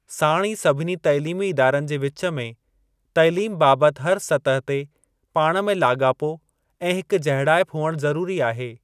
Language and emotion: Sindhi, neutral